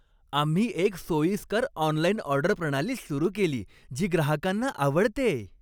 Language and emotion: Marathi, happy